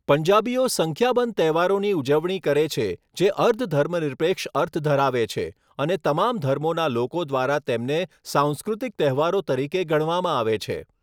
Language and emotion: Gujarati, neutral